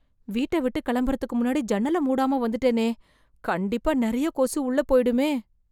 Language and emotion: Tamil, fearful